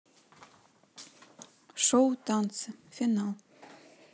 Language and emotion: Russian, neutral